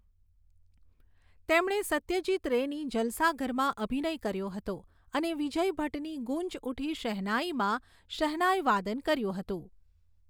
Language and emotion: Gujarati, neutral